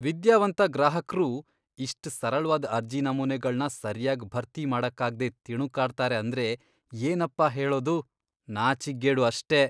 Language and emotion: Kannada, disgusted